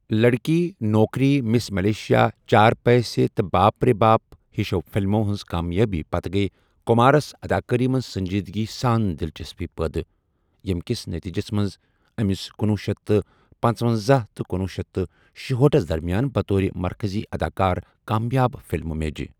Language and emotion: Kashmiri, neutral